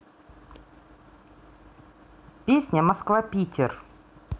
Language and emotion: Russian, neutral